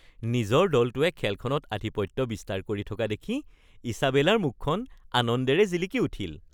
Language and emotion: Assamese, happy